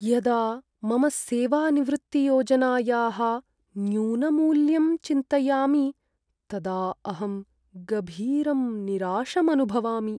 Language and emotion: Sanskrit, sad